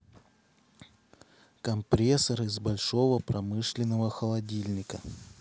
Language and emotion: Russian, neutral